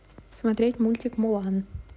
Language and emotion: Russian, neutral